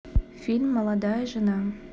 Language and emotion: Russian, neutral